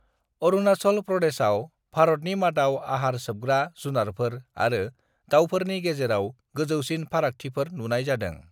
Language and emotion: Bodo, neutral